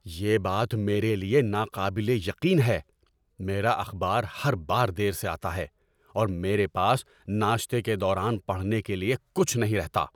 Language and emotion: Urdu, angry